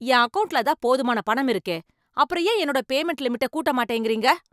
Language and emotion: Tamil, angry